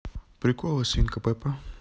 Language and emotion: Russian, neutral